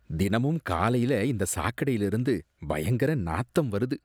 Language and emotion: Tamil, disgusted